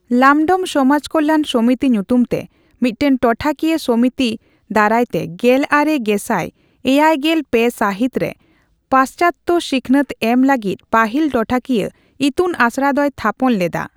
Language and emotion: Santali, neutral